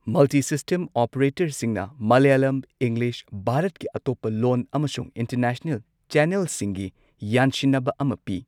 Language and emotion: Manipuri, neutral